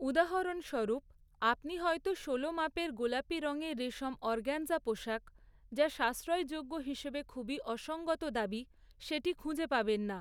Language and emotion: Bengali, neutral